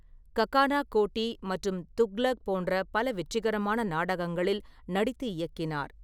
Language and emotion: Tamil, neutral